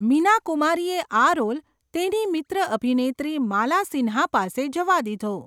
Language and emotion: Gujarati, neutral